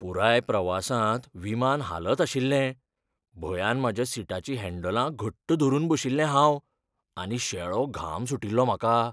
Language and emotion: Goan Konkani, fearful